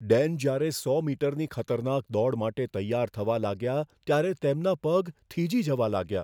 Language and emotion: Gujarati, fearful